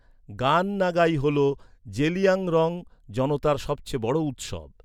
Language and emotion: Bengali, neutral